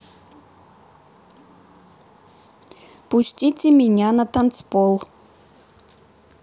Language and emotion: Russian, neutral